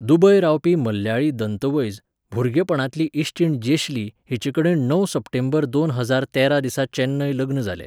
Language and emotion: Goan Konkani, neutral